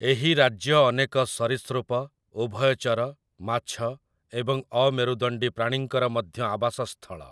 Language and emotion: Odia, neutral